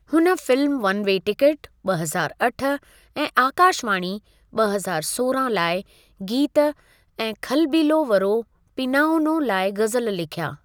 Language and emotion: Sindhi, neutral